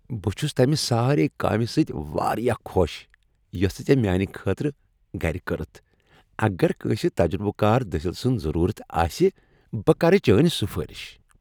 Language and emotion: Kashmiri, happy